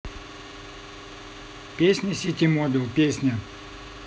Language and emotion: Russian, neutral